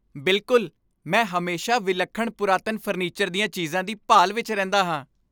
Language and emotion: Punjabi, happy